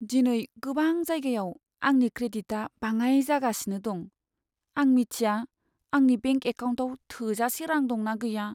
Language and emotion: Bodo, sad